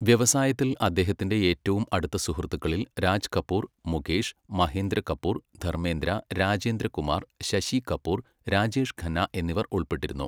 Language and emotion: Malayalam, neutral